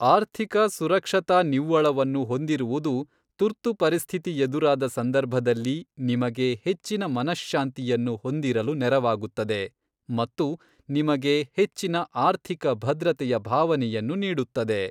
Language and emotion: Kannada, neutral